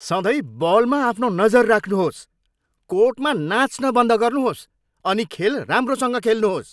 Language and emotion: Nepali, angry